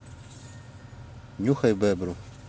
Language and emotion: Russian, neutral